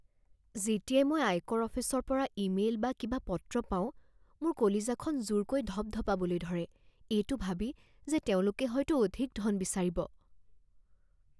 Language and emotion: Assamese, fearful